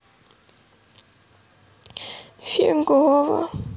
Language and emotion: Russian, sad